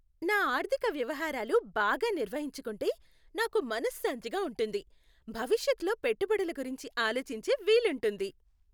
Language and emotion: Telugu, happy